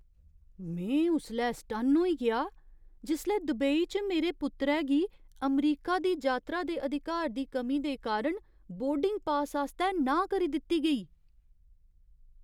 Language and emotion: Dogri, surprised